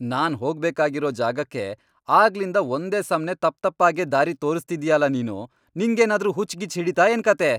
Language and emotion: Kannada, angry